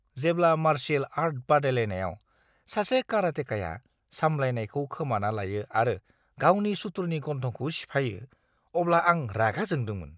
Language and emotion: Bodo, disgusted